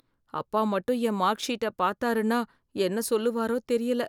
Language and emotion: Tamil, fearful